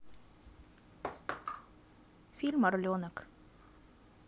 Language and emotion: Russian, neutral